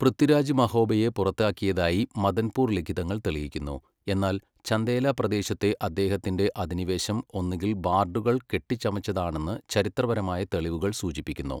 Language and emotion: Malayalam, neutral